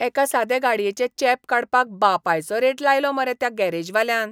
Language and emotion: Goan Konkani, disgusted